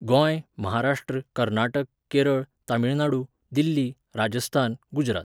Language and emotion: Goan Konkani, neutral